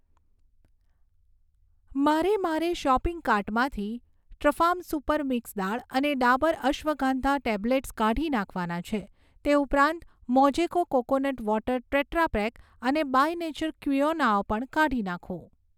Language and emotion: Gujarati, neutral